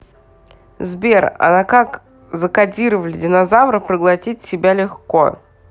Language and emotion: Russian, neutral